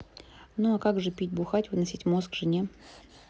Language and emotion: Russian, neutral